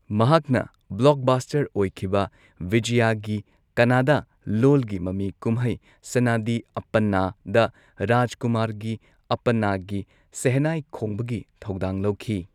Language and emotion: Manipuri, neutral